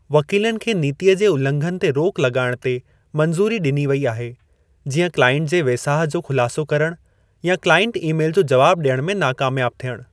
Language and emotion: Sindhi, neutral